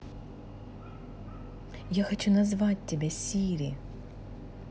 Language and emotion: Russian, positive